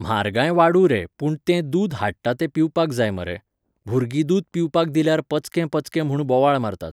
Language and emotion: Goan Konkani, neutral